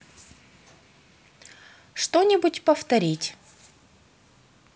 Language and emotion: Russian, neutral